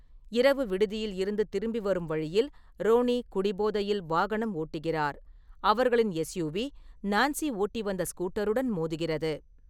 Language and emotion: Tamil, neutral